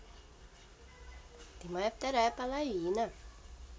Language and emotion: Russian, positive